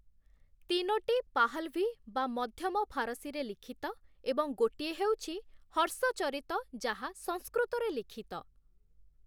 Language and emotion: Odia, neutral